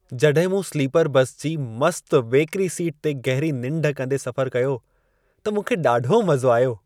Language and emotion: Sindhi, happy